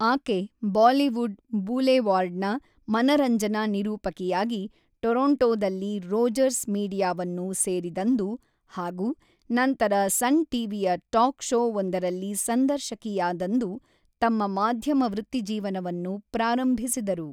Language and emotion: Kannada, neutral